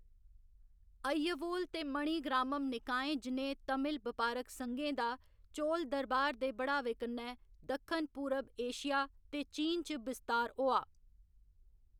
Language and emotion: Dogri, neutral